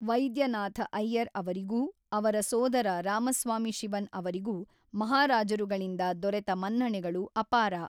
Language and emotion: Kannada, neutral